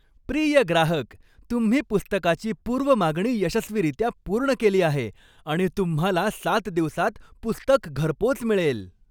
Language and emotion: Marathi, happy